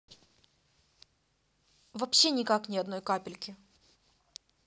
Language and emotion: Russian, neutral